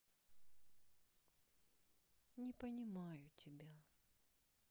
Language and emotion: Russian, sad